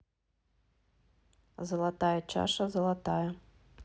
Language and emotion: Russian, neutral